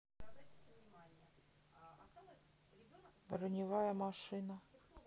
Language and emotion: Russian, neutral